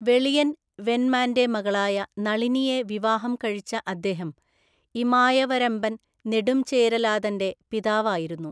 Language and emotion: Malayalam, neutral